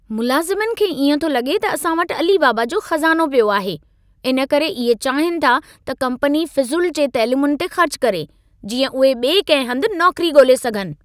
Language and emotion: Sindhi, angry